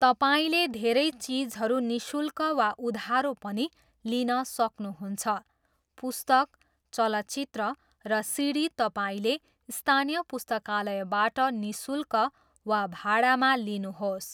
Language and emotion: Nepali, neutral